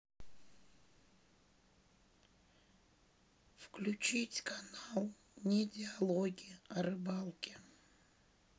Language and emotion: Russian, sad